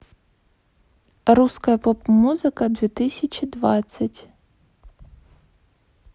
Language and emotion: Russian, neutral